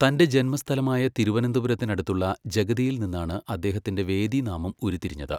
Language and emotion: Malayalam, neutral